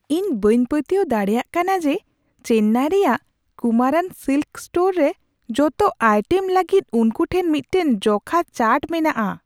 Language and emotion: Santali, surprised